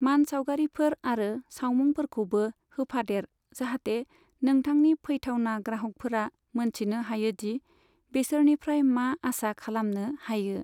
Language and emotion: Bodo, neutral